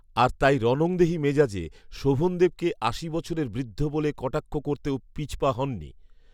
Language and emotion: Bengali, neutral